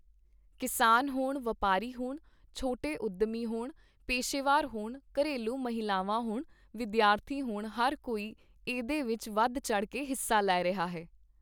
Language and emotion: Punjabi, neutral